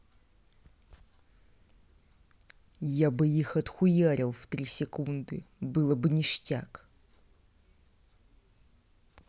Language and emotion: Russian, angry